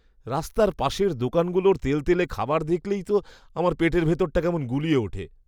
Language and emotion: Bengali, disgusted